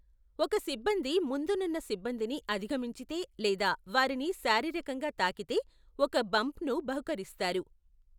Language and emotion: Telugu, neutral